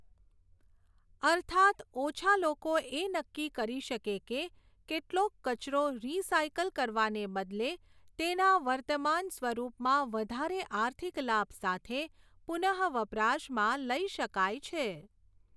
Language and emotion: Gujarati, neutral